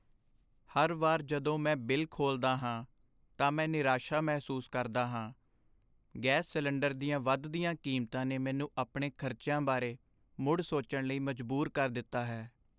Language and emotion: Punjabi, sad